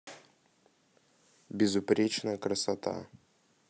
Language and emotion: Russian, neutral